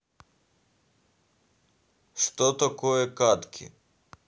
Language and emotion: Russian, neutral